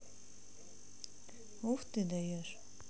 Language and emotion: Russian, neutral